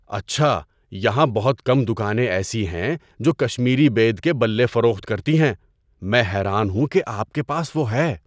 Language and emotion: Urdu, surprised